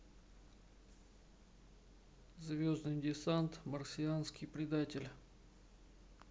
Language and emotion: Russian, neutral